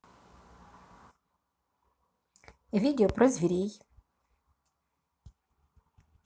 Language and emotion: Russian, positive